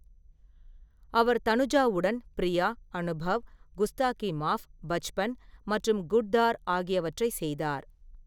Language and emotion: Tamil, neutral